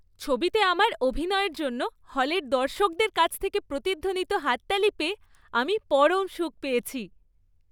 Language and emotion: Bengali, happy